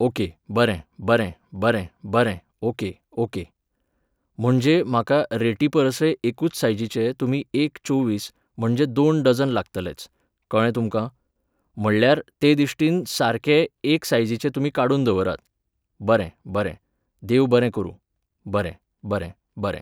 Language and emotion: Goan Konkani, neutral